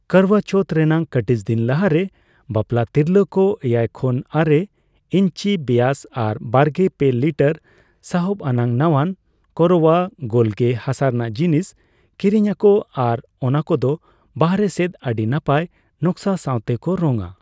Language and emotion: Santali, neutral